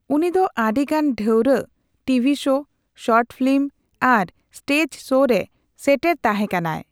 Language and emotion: Santali, neutral